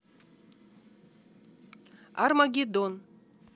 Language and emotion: Russian, neutral